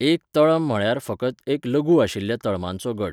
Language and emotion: Goan Konkani, neutral